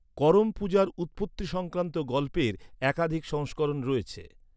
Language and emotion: Bengali, neutral